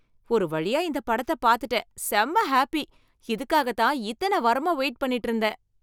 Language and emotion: Tamil, happy